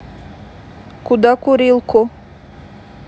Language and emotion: Russian, neutral